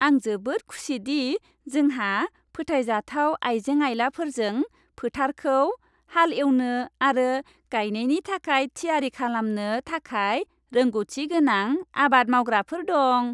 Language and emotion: Bodo, happy